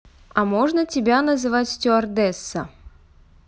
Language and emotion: Russian, neutral